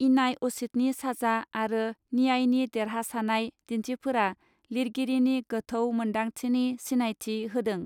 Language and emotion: Bodo, neutral